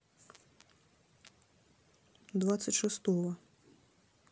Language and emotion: Russian, neutral